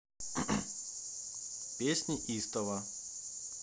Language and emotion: Russian, neutral